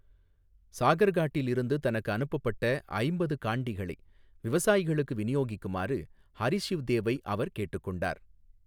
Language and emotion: Tamil, neutral